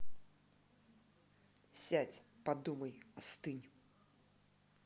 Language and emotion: Russian, angry